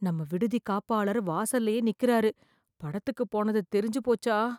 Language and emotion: Tamil, fearful